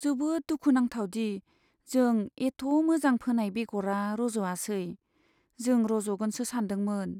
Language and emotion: Bodo, sad